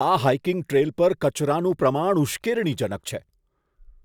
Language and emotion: Gujarati, disgusted